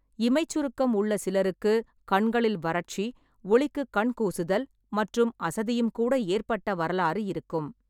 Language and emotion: Tamil, neutral